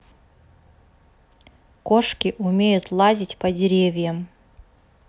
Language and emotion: Russian, neutral